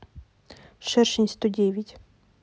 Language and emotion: Russian, neutral